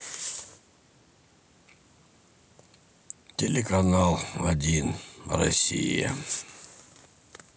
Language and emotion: Russian, sad